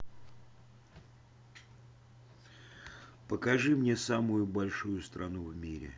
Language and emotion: Russian, neutral